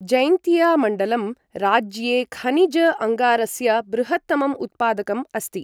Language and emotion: Sanskrit, neutral